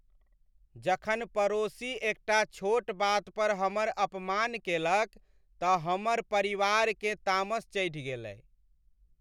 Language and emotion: Maithili, sad